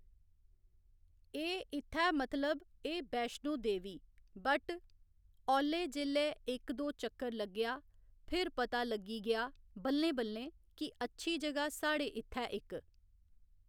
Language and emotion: Dogri, neutral